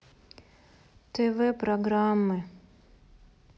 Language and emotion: Russian, sad